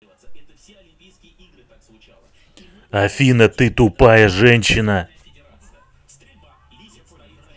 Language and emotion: Russian, angry